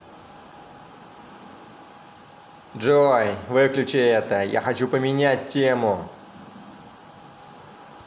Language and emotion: Russian, angry